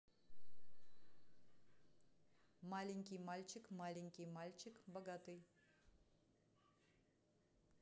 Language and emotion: Russian, neutral